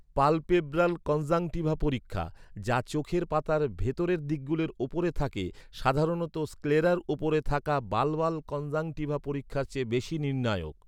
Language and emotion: Bengali, neutral